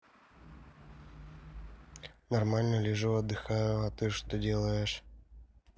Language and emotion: Russian, neutral